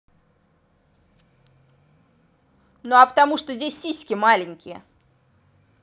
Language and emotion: Russian, angry